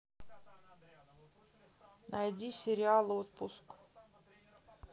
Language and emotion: Russian, neutral